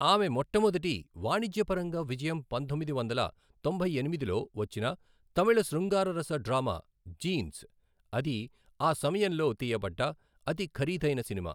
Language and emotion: Telugu, neutral